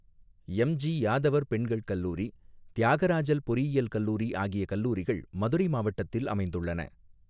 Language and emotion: Tamil, neutral